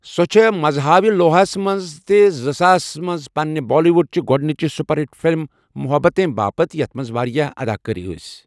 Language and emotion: Kashmiri, neutral